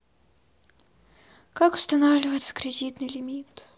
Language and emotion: Russian, sad